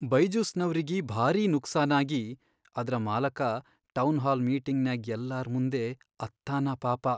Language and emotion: Kannada, sad